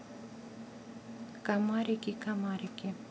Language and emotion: Russian, neutral